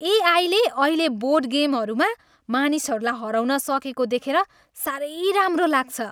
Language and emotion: Nepali, happy